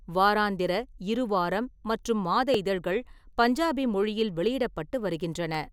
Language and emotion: Tamil, neutral